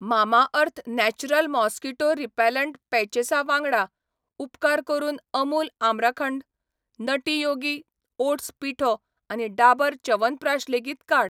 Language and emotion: Goan Konkani, neutral